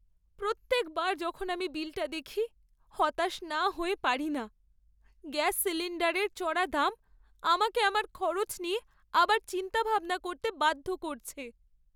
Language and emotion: Bengali, sad